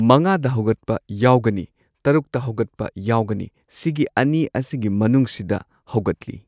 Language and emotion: Manipuri, neutral